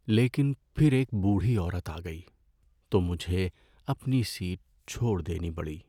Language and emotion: Urdu, sad